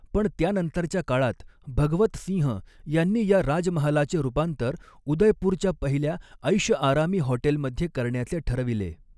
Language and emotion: Marathi, neutral